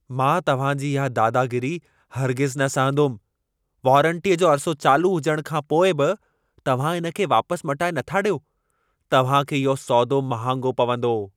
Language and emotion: Sindhi, angry